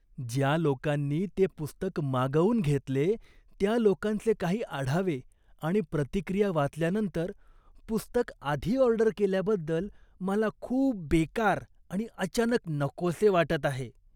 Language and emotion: Marathi, disgusted